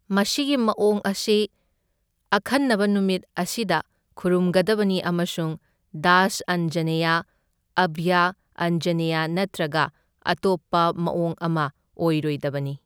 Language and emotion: Manipuri, neutral